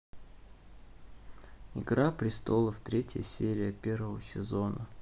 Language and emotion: Russian, neutral